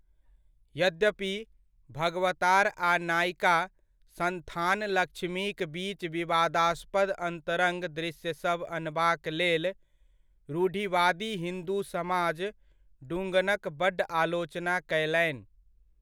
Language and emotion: Maithili, neutral